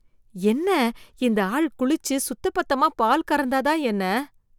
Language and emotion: Tamil, disgusted